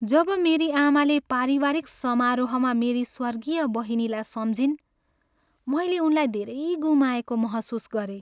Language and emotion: Nepali, sad